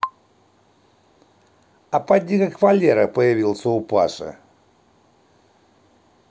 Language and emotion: Russian, neutral